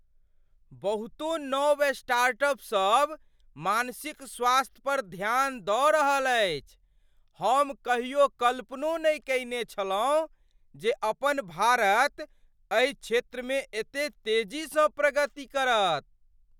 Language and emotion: Maithili, surprised